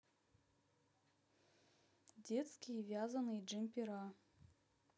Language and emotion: Russian, neutral